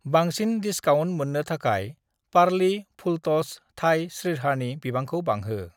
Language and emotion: Bodo, neutral